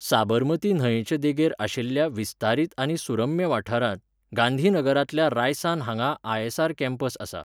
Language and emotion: Goan Konkani, neutral